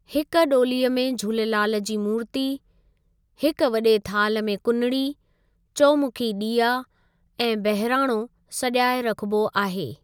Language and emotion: Sindhi, neutral